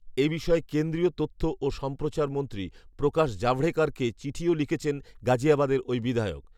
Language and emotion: Bengali, neutral